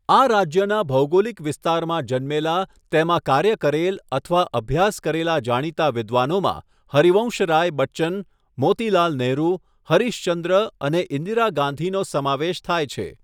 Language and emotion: Gujarati, neutral